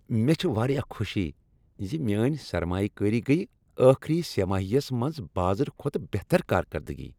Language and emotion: Kashmiri, happy